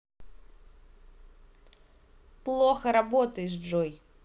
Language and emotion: Russian, angry